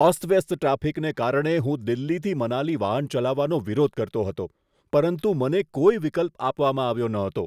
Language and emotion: Gujarati, disgusted